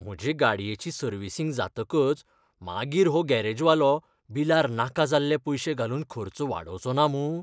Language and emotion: Goan Konkani, fearful